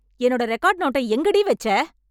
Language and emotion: Tamil, angry